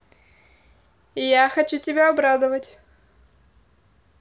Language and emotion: Russian, positive